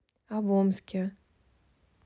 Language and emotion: Russian, neutral